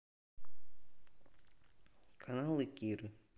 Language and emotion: Russian, neutral